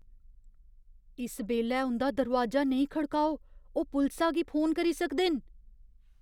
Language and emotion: Dogri, fearful